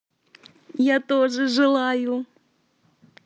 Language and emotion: Russian, positive